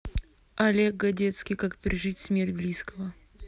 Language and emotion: Russian, neutral